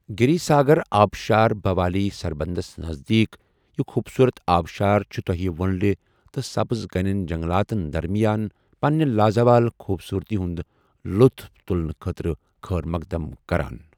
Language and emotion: Kashmiri, neutral